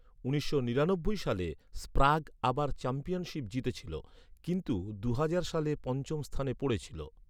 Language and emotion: Bengali, neutral